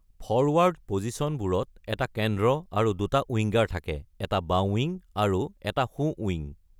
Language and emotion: Assamese, neutral